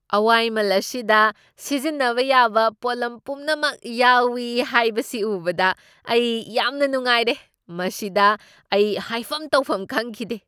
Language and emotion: Manipuri, surprised